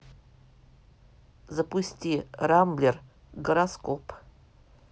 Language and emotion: Russian, neutral